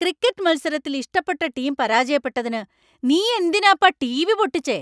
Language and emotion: Malayalam, angry